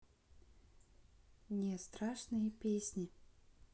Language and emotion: Russian, neutral